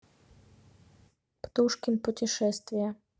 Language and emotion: Russian, neutral